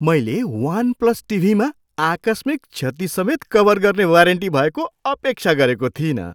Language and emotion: Nepali, surprised